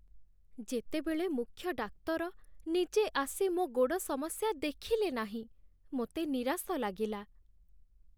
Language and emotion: Odia, sad